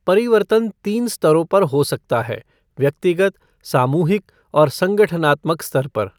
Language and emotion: Hindi, neutral